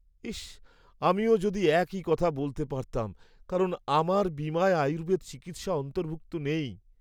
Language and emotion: Bengali, sad